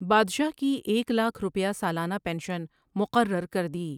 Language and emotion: Urdu, neutral